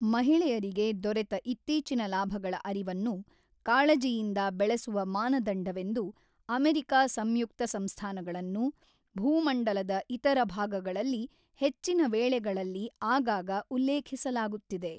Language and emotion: Kannada, neutral